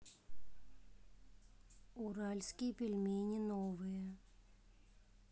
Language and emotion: Russian, neutral